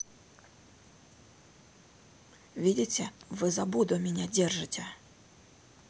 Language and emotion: Russian, neutral